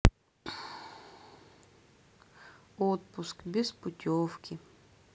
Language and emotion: Russian, sad